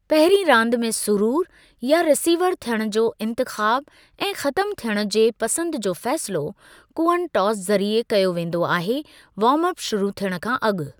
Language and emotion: Sindhi, neutral